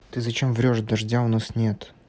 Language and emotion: Russian, neutral